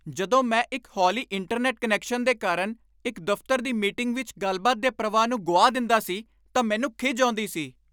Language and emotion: Punjabi, angry